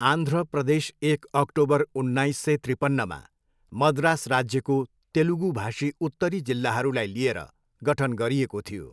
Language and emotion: Nepali, neutral